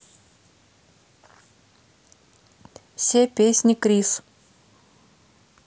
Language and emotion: Russian, neutral